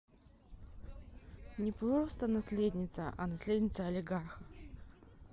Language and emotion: Russian, neutral